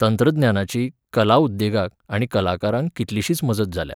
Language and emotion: Goan Konkani, neutral